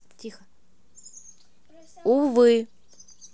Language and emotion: Russian, neutral